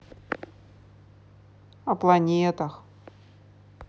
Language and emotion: Russian, neutral